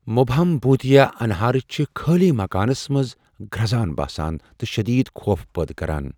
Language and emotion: Kashmiri, fearful